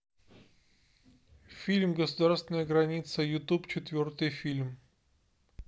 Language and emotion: Russian, neutral